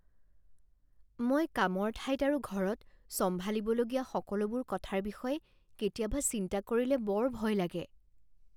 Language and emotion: Assamese, fearful